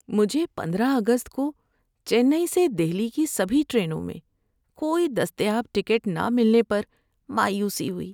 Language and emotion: Urdu, sad